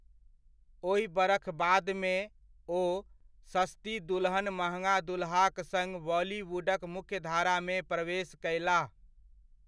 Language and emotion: Maithili, neutral